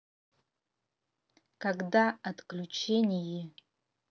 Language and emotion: Russian, neutral